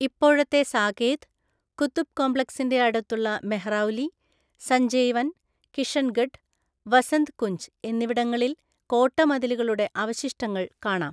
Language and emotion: Malayalam, neutral